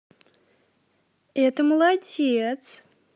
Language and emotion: Russian, positive